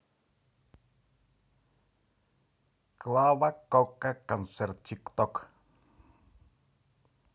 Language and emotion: Russian, positive